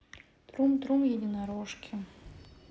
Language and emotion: Russian, sad